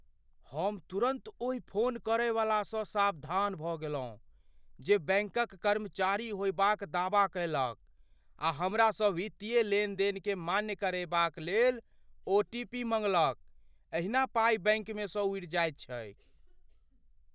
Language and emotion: Maithili, fearful